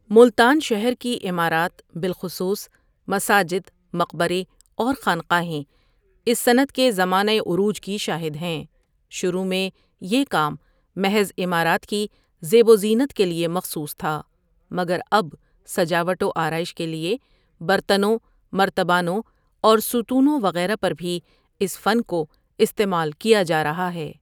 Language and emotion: Urdu, neutral